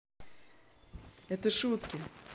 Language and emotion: Russian, positive